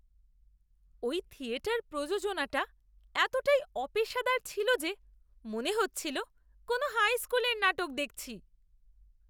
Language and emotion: Bengali, disgusted